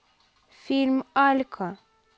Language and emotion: Russian, neutral